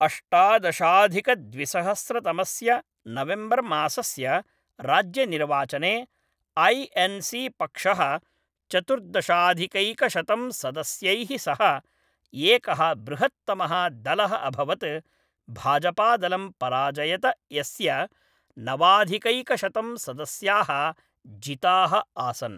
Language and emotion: Sanskrit, neutral